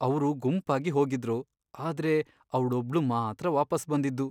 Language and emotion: Kannada, sad